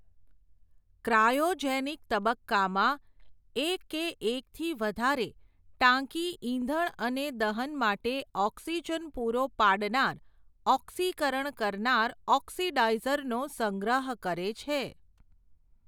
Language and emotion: Gujarati, neutral